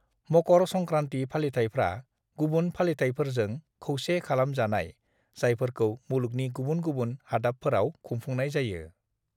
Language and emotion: Bodo, neutral